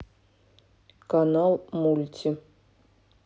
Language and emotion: Russian, neutral